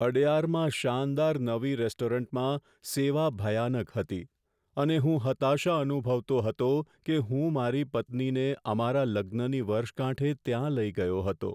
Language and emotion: Gujarati, sad